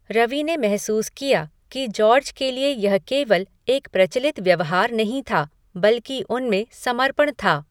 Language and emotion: Hindi, neutral